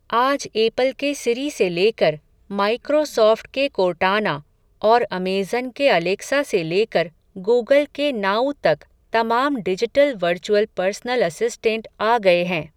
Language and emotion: Hindi, neutral